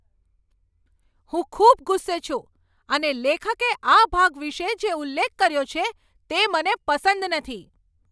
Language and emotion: Gujarati, angry